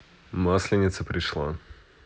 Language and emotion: Russian, neutral